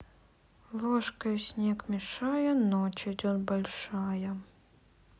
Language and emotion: Russian, sad